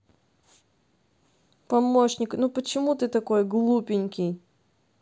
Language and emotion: Russian, neutral